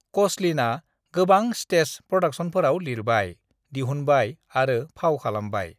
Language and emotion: Bodo, neutral